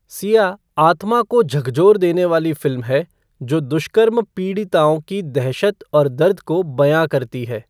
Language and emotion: Hindi, neutral